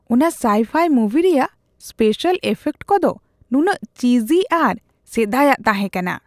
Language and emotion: Santali, disgusted